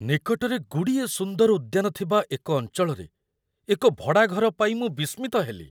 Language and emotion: Odia, surprised